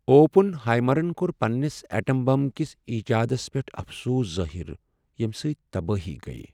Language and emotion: Kashmiri, sad